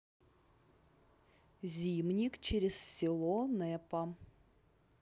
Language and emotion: Russian, neutral